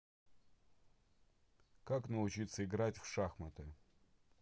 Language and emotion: Russian, neutral